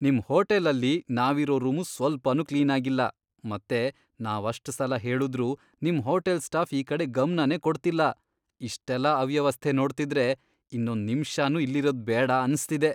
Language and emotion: Kannada, disgusted